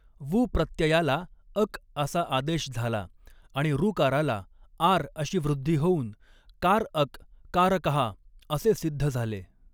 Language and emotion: Marathi, neutral